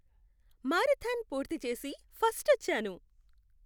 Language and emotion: Telugu, happy